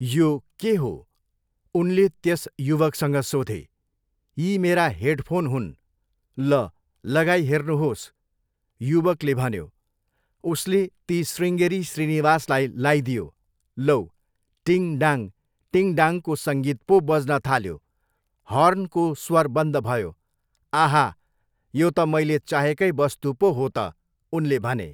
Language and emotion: Nepali, neutral